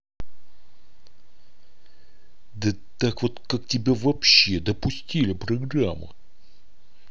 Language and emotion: Russian, angry